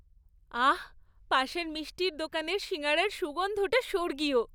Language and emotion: Bengali, happy